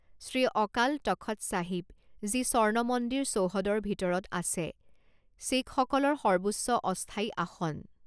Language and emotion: Assamese, neutral